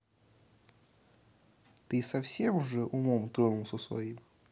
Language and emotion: Russian, neutral